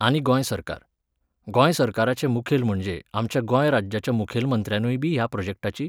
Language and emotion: Goan Konkani, neutral